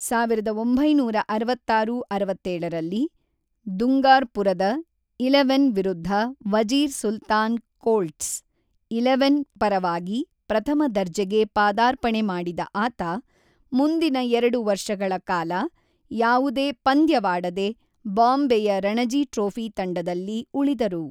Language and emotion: Kannada, neutral